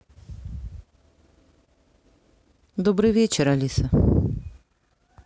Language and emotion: Russian, neutral